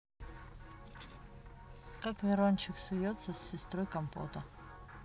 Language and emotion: Russian, neutral